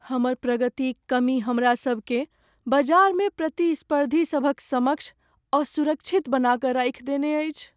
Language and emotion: Maithili, sad